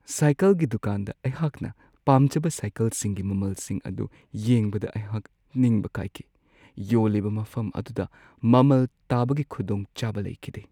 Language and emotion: Manipuri, sad